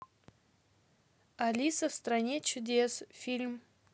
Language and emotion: Russian, neutral